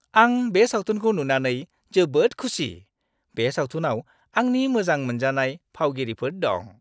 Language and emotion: Bodo, happy